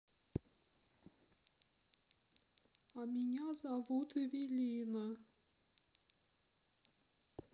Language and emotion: Russian, sad